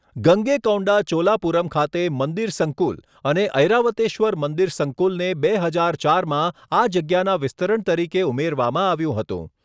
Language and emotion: Gujarati, neutral